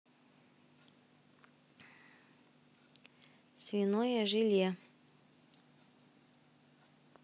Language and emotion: Russian, neutral